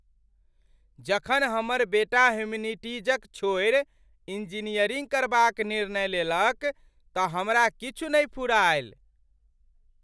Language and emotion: Maithili, surprised